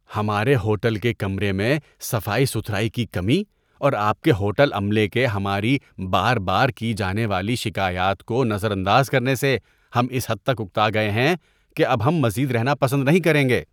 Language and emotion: Urdu, disgusted